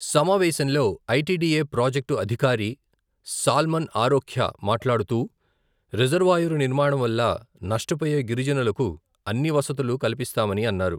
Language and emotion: Telugu, neutral